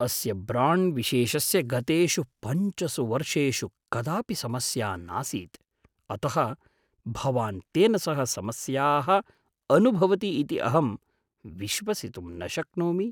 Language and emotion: Sanskrit, surprised